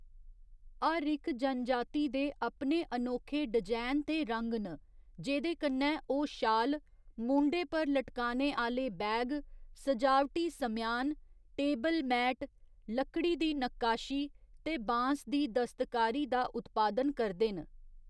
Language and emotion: Dogri, neutral